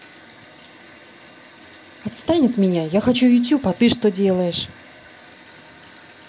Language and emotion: Russian, angry